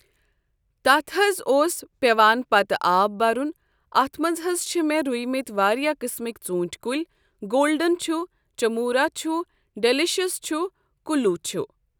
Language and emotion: Kashmiri, neutral